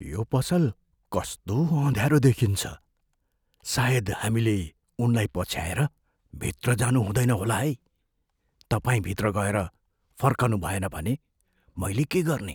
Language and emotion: Nepali, fearful